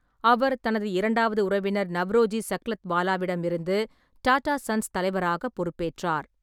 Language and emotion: Tamil, neutral